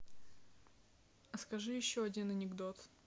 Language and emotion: Russian, neutral